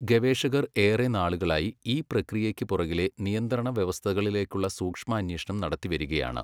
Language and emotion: Malayalam, neutral